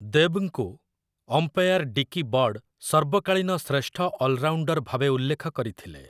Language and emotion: Odia, neutral